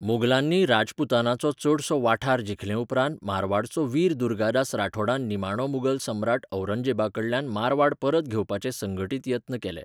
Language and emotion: Goan Konkani, neutral